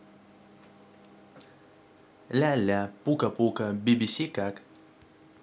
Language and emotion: Russian, neutral